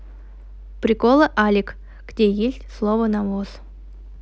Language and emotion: Russian, neutral